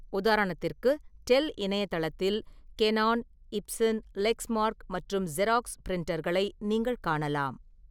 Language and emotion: Tamil, neutral